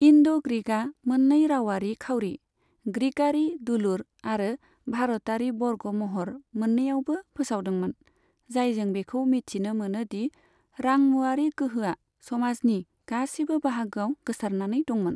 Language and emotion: Bodo, neutral